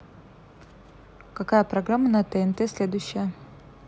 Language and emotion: Russian, neutral